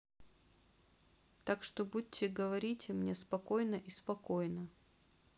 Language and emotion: Russian, neutral